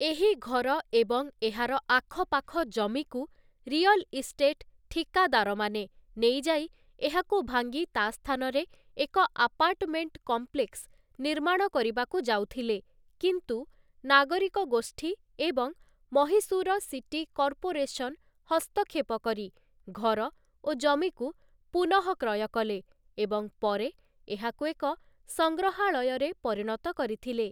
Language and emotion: Odia, neutral